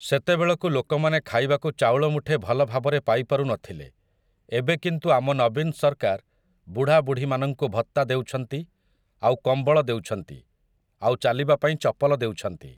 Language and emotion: Odia, neutral